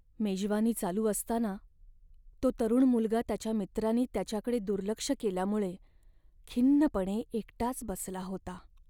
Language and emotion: Marathi, sad